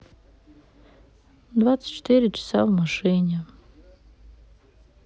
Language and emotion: Russian, sad